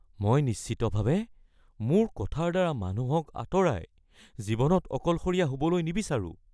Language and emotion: Assamese, fearful